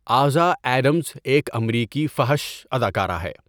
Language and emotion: Urdu, neutral